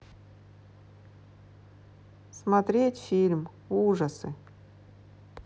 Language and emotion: Russian, neutral